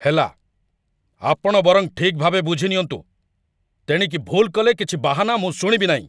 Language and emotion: Odia, angry